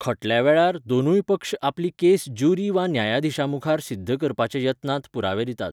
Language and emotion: Goan Konkani, neutral